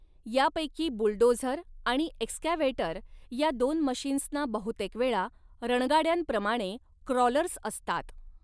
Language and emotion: Marathi, neutral